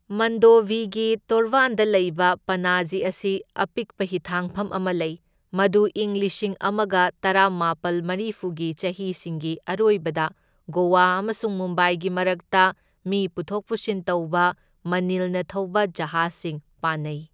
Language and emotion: Manipuri, neutral